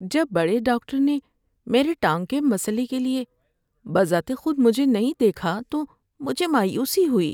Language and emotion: Urdu, sad